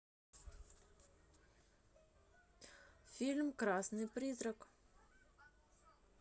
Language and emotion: Russian, neutral